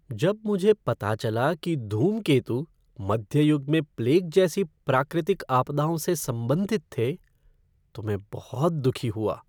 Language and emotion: Hindi, sad